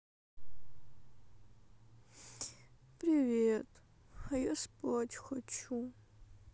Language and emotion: Russian, sad